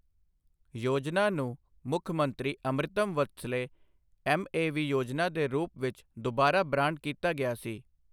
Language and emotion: Punjabi, neutral